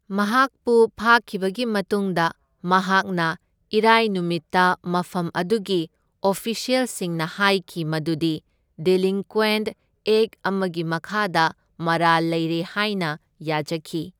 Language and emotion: Manipuri, neutral